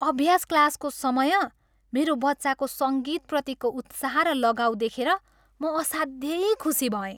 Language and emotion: Nepali, happy